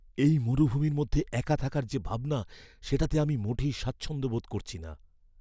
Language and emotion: Bengali, fearful